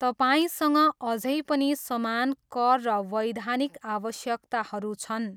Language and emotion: Nepali, neutral